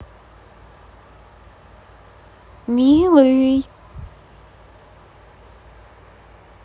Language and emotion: Russian, positive